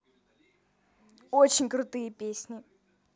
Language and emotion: Russian, positive